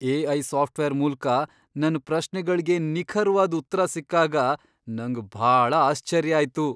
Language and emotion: Kannada, surprised